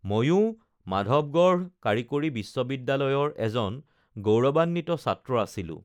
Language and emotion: Assamese, neutral